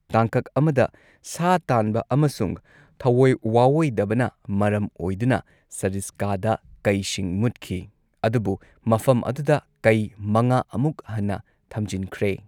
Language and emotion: Manipuri, neutral